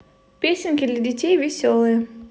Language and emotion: Russian, positive